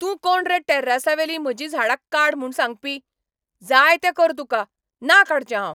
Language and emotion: Goan Konkani, angry